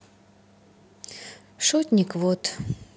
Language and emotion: Russian, sad